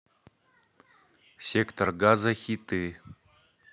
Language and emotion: Russian, neutral